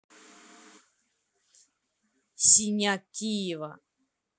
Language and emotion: Russian, neutral